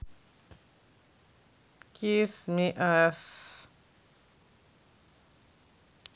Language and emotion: Russian, neutral